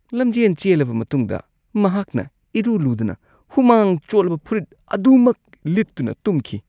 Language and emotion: Manipuri, disgusted